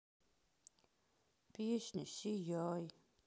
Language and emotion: Russian, sad